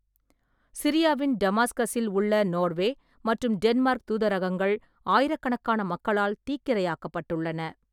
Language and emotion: Tamil, neutral